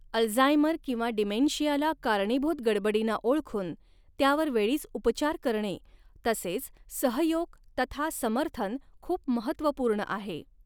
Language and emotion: Marathi, neutral